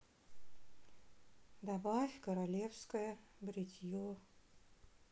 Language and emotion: Russian, sad